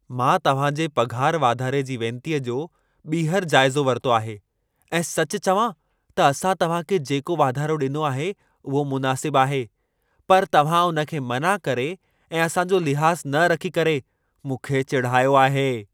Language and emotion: Sindhi, angry